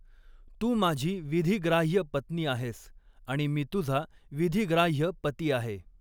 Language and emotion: Marathi, neutral